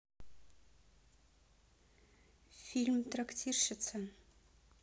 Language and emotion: Russian, neutral